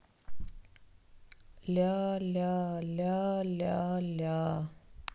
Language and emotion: Russian, sad